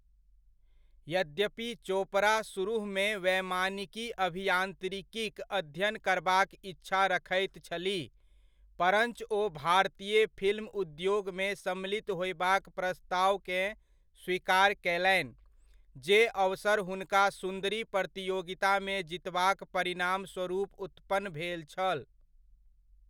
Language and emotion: Maithili, neutral